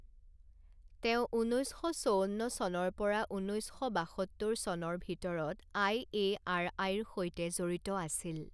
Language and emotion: Assamese, neutral